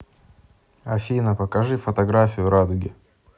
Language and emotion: Russian, neutral